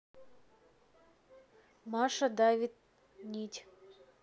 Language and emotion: Russian, neutral